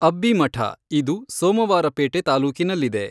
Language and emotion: Kannada, neutral